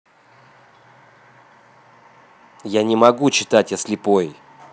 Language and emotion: Russian, angry